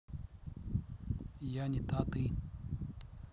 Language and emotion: Russian, neutral